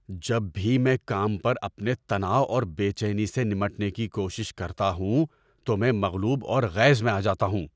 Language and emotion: Urdu, angry